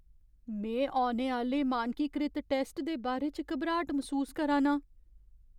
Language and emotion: Dogri, fearful